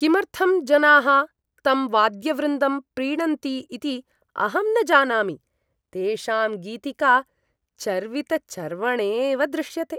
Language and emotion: Sanskrit, disgusted